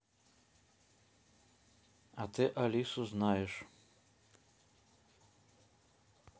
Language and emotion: Russian, neutral